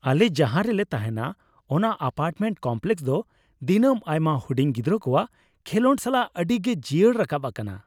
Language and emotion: Santali, happy